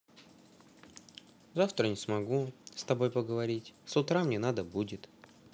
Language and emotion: Russian, sad